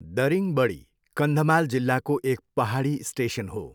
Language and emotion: Nepali, neutral